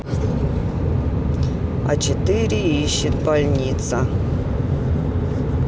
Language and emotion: Russian, neutral